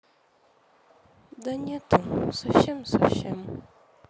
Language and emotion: Russian, sad